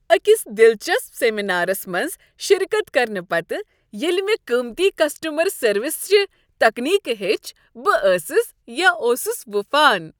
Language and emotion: Kashmiri, happy